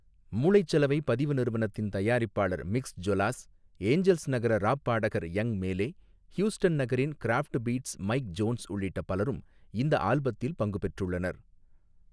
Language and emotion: Tamil, neutral